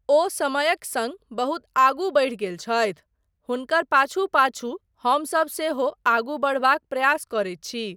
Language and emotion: Maithili, neutral